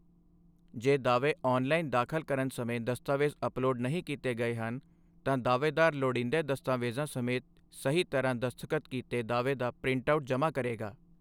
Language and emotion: Punjabi, neutral